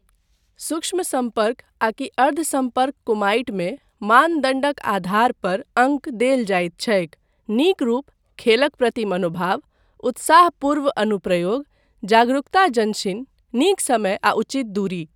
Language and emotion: Maithili, neutral